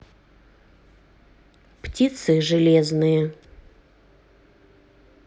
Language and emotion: Russian, neutral